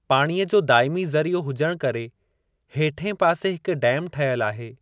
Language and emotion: Sindhi, neutral